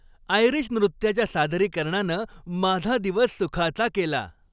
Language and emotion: Marathi, happy